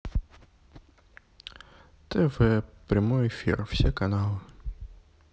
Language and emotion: Russian, neutral